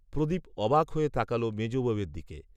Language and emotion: Bengali, neutral